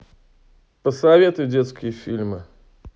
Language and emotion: Russian, neutral